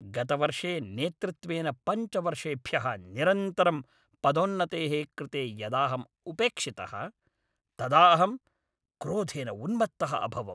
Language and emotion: Sanskrit, angry